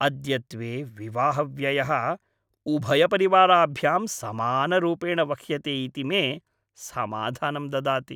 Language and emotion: Sanskrit, happy